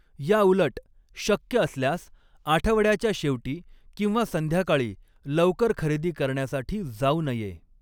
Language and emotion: Marathi, neutral